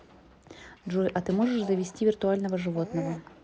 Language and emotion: Russian, neutral